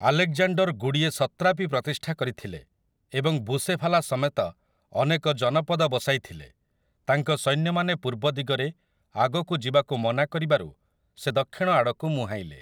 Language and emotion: Odia, neutral